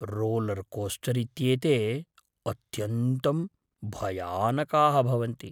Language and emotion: Sanskrit, fearful